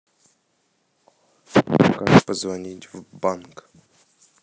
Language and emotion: Russian, neutral